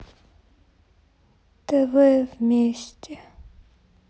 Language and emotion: Russian, sad